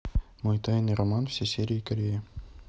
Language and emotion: Russian, neutral